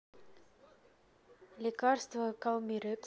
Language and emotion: Russian, neutral